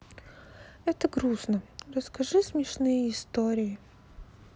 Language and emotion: Russian, sad